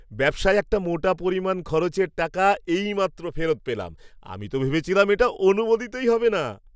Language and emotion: Bengali, happy